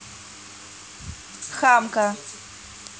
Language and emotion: Russian, angry